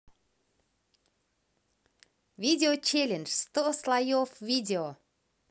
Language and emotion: Russian, positive